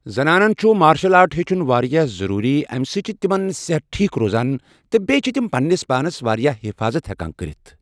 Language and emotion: Kashmiri, neutral